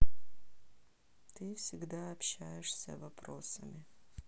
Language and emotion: Russian, sad